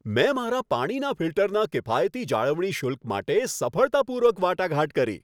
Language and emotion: Gujarati, happy